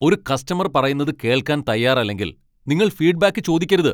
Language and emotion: Malayalam, angry